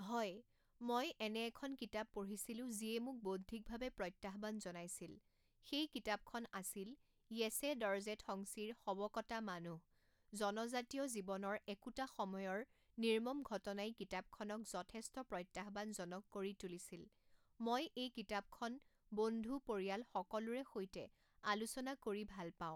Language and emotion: Assamese, neutral